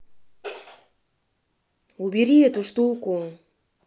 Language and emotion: Russian, angry